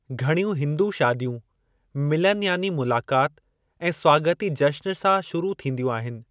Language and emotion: Sindhi, neutral